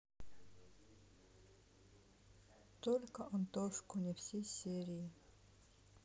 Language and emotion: Russian, sad